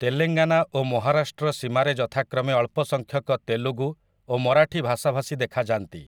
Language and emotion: Odia, neutral